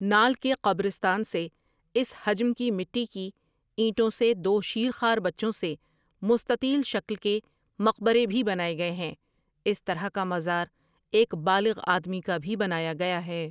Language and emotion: Urdu, neutral